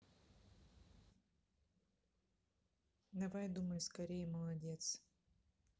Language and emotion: Russian, neutral